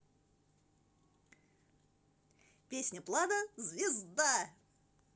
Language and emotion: Russian, positive